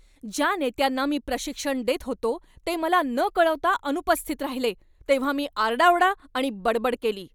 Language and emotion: Marathi, angry